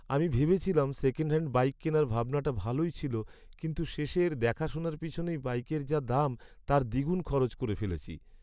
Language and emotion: Bengali, sad